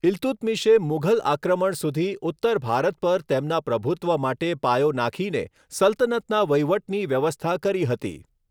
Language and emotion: Gujarati, neutral